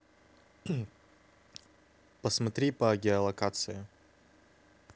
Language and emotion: Russian, neutral